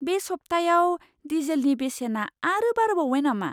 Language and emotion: Bodo, surprised